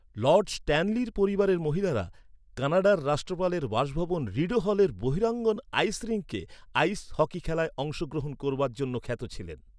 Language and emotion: Bengali, neutral